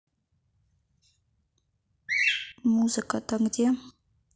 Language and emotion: Russian, neutral